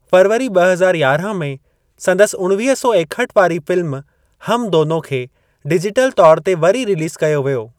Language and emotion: Sindhi, neutral